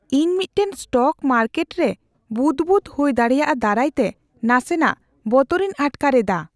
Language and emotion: Santali, fearful